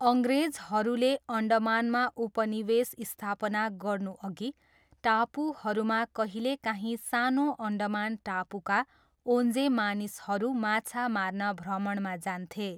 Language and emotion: Nepali, neutral